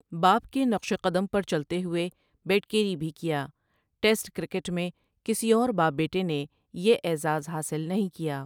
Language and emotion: Urdu, neutral